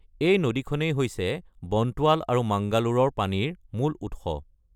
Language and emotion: Assamese, neutral